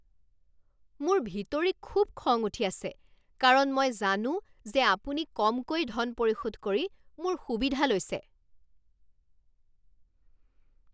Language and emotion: Assamese, angry